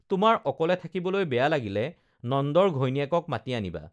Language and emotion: Assamese, neutral